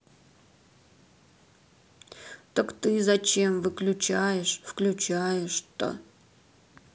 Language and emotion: Russian, sad